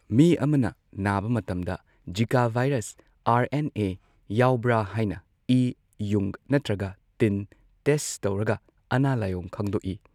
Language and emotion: Manipuri, neutral